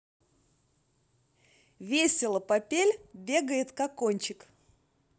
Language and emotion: Russian, positive